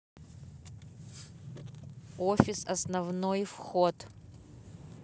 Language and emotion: Russian, neutral